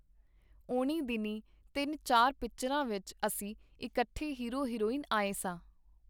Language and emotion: Punjabi, neutral